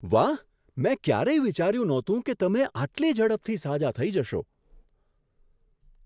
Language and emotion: Gujarati, surprised